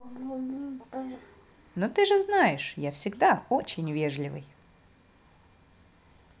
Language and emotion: Russian, positive